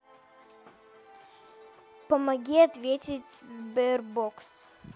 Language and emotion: Russian, neutral